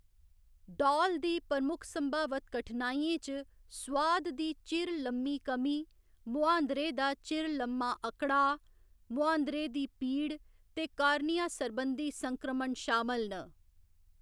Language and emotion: Dogri, neutral